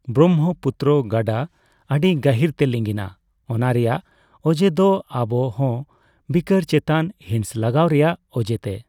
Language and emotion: Santali, neutral